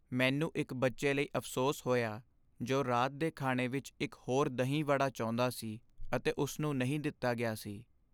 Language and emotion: Punjabi, sad